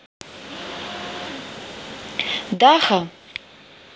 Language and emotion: Russian, neutral